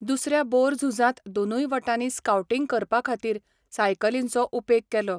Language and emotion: Goan Konkani, neutral